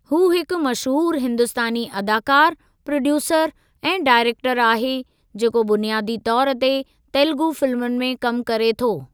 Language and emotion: Sindhi, neutral